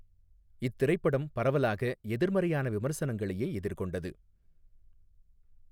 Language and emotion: Tamil, neutral